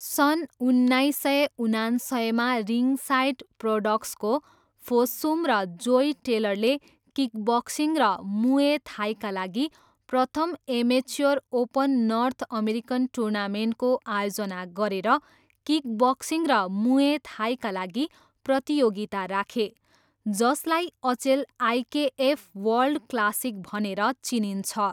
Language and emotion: Nepali, neutral